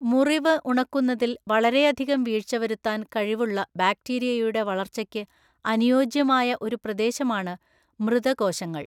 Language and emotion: Malayalam, neutral